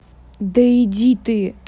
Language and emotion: Russian, angry